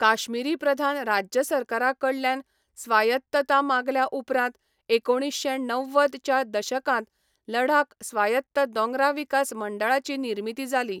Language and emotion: Goan Konkani, neutral